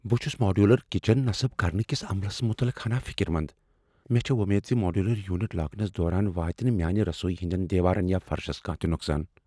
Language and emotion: Kashmiri, fearful